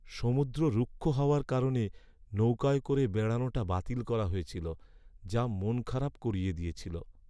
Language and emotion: Bengali, sad